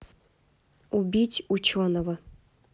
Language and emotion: Russian, neutral